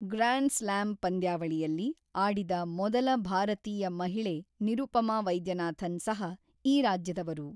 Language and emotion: Kannada, neutral